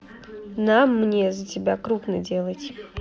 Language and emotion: Russian, neutral